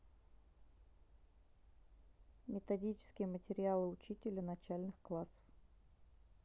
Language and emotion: Russian, neutral